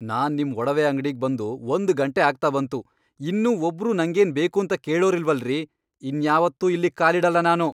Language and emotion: Kannada, angry